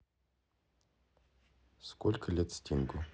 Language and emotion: Russian, neutral